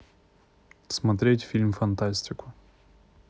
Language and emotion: Russian, neutral